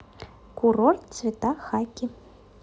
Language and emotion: Russian, neutral